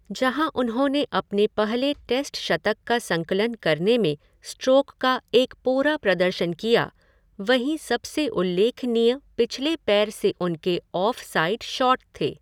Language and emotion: Hindi, neutral